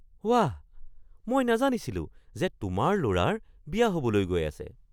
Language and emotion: Assamese, surprised